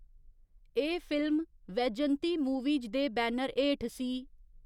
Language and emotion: Dogri, neutral